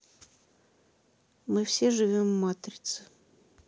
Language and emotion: Russian, sad